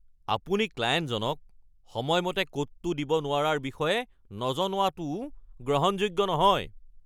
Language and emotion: Assamese, angry